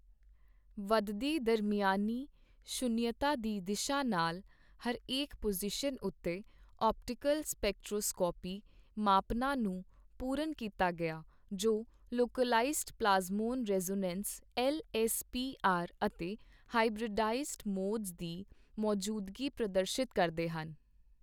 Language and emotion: Punjabi, neutral